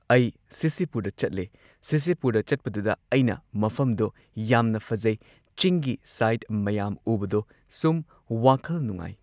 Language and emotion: Manipuri, neutral